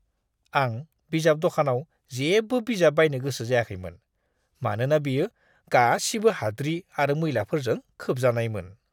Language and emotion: Bodo, disgusted